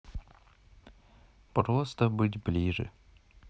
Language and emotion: Russian, neutral